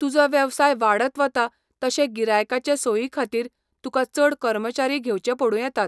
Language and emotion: Goan Konkani, neutral